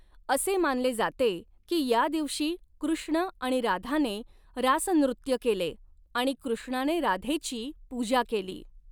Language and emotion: Marathi, neutral